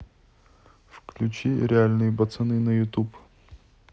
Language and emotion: Russian, neutral